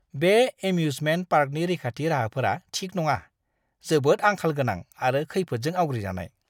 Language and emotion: Bodo, disgusted